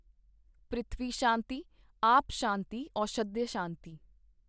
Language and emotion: Punjabi, neutral